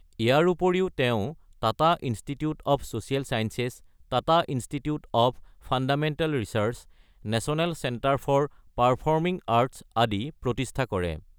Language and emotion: Assamese, neutral